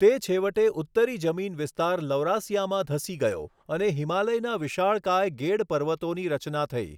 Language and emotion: Gujarati, neutral